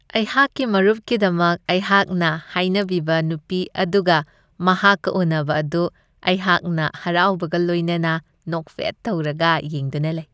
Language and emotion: Manipuri, happy